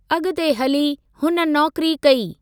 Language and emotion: Sindhi, neutral